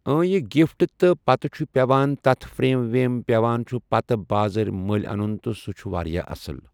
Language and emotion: Kashmiri, neutral